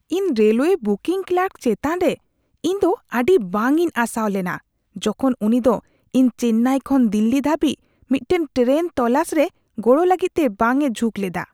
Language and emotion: Santali, disgusted